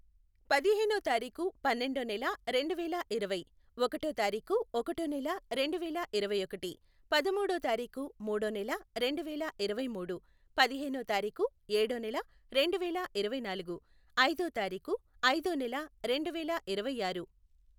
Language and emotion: Telugu, neutral